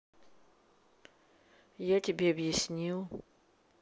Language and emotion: Russian, neutral